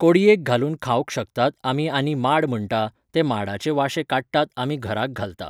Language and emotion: Goan Konkani, neutral